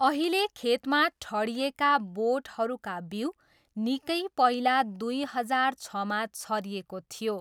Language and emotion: Nepali, neutral